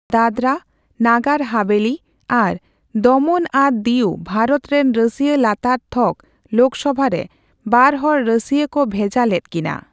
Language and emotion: Santali, neutral